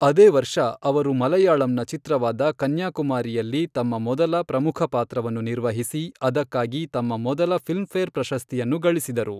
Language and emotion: Kannada, neutral